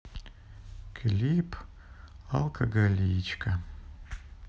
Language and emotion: Russian, sad